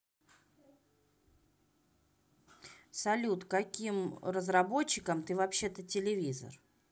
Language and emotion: Russian, neutral